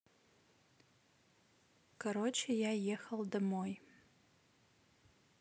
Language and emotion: Russian, neutral